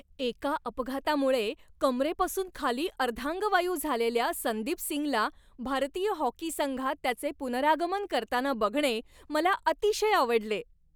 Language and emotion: Marathi, happy